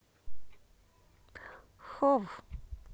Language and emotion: Russian, neutral